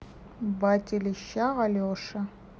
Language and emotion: Russian, neutral